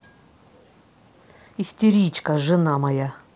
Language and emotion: Russian, angry